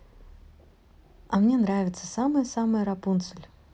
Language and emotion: Russian, positive